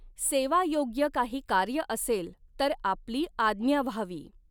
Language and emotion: Marathi, neutral